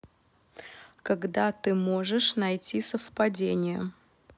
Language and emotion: Russian, neutral